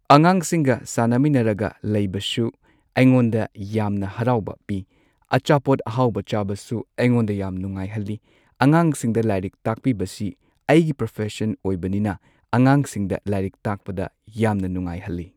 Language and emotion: Manipuri, neutral